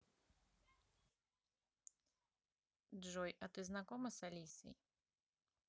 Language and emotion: Russian, neutral